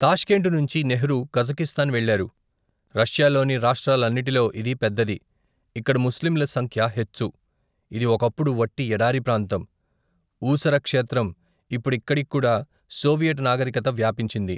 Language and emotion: Telugu, neutral